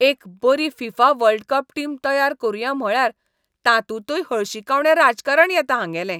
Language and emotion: Goan Konkani, disgusted